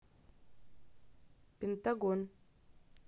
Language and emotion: Russian, neutral